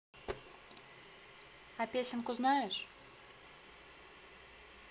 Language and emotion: Russian, neutral